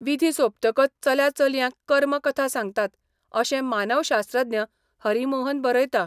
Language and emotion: Goan Konkani, neutral